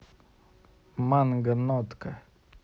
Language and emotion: Russian, neutral